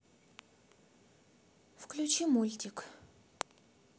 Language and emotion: Russian, neutral